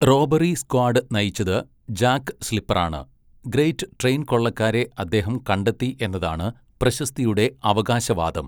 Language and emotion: Malayalam, neutral